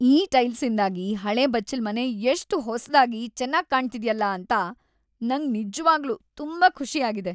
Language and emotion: Kannada, happy